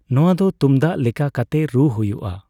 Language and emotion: Santali, neutral